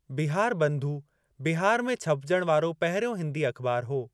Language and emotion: Sindhi, neutral